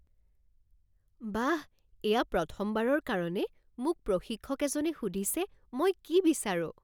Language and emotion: Assamese, surprised